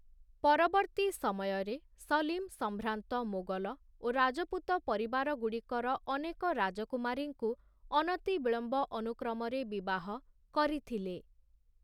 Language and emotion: Odia, neutral